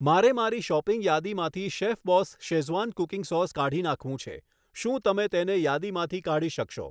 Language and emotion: Gujarati, neutral